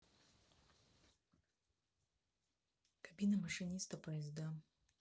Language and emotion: Russian, neutral